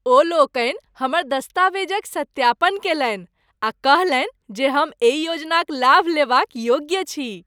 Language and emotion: Maithili, happy